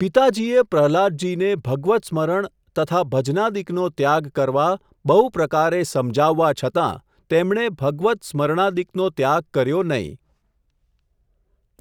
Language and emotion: Gujarati, neutral